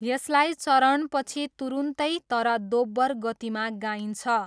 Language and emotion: Nepali, neutral